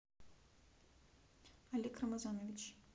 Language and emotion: Russian, neutral